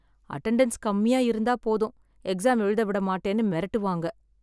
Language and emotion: Tamil, sad